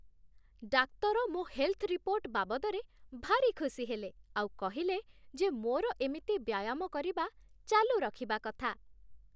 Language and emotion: Odia, happy